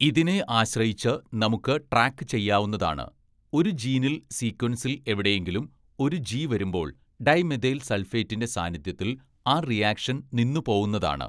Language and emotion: Malayalam, neutral